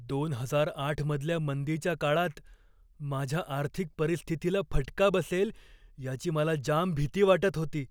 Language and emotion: Marathi, fearful